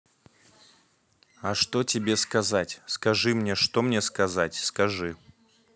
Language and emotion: Russian, neutral